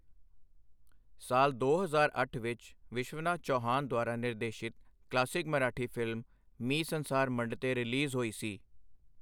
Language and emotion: Punjabi, neutral